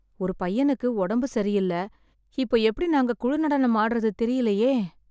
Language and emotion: Tamil, sad